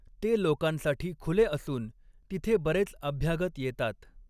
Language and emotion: Marathi, neutral